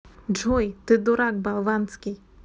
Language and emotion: Russian, neutral